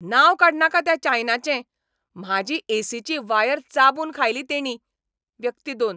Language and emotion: Goan Konkani, angry